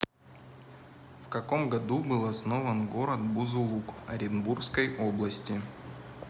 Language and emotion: Russian, neutral